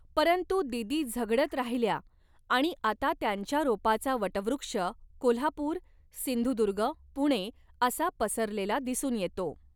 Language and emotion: Marathi, neutral